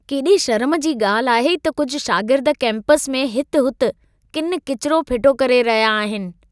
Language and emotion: Sindhi, disgusted